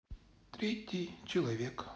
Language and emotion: Russian, neutral